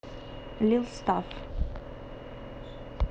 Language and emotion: Russian, neutral